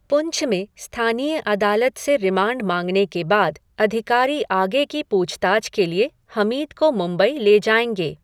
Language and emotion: Hindi, neutral